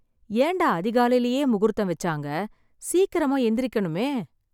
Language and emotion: Tamil, sad